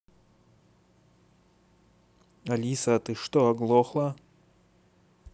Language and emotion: Russian, neutral